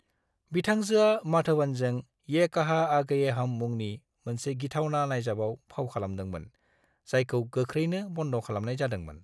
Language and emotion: Bodo, neutral